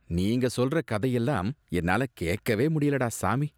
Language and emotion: Tamil, disgusted